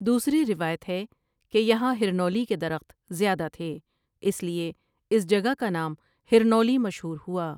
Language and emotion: Urdu, neutral